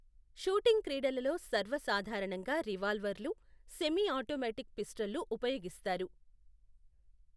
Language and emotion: Telugu, neutral